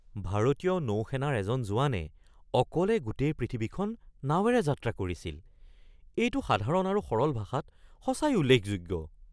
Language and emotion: Assamese, surprised